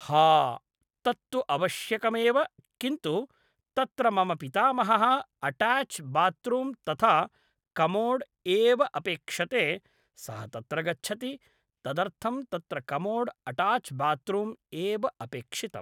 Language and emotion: Sanskrit, neutral